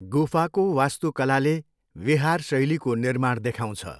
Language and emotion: Nepali, neutral